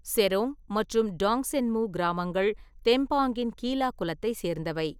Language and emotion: Tamil, neutral